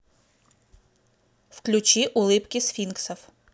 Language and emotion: Russian, neutral